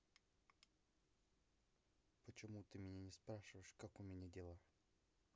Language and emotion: Russian, sad